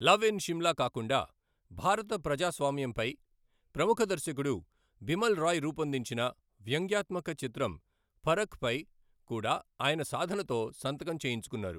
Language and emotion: Telugu, neutral